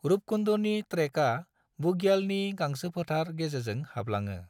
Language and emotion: Bodo, neutral